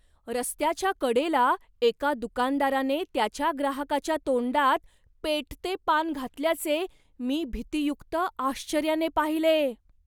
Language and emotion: Marathi, surprised